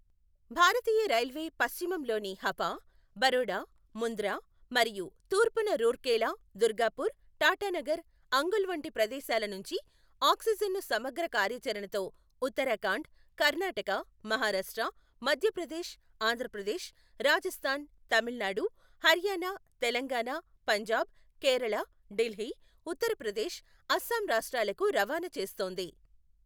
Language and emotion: Telugu, neutral